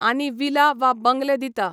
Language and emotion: Goan Konkani, neutral